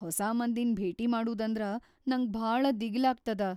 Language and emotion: Kannada, fearful